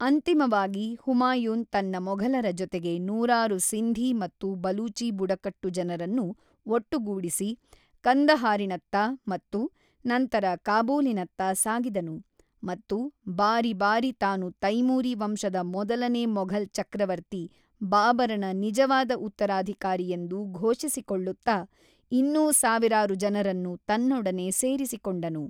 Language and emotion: Kannada, neutral